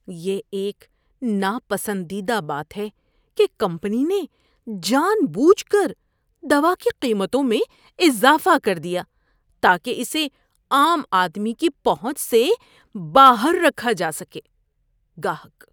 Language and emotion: Urdu, disgusted